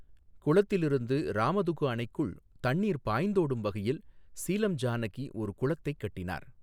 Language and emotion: Tamil, neutral